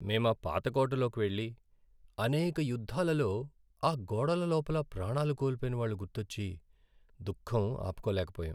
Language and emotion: Telugu, sad